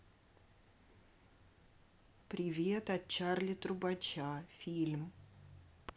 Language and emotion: Russian, neutral